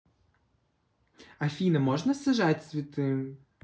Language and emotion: Russian, neutral